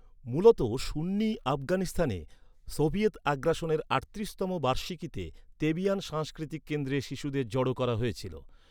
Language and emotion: Bengali, neutral